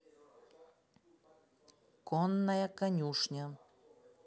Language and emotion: Russian, neutral